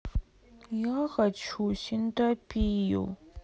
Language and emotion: Russian, sad